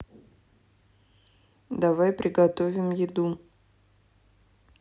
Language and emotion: Russian, neutral